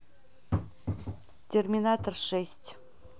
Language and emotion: Russian, neutral